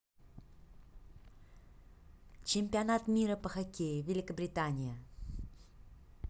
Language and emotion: Russian, neutral